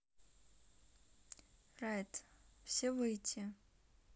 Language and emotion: Russian, neutral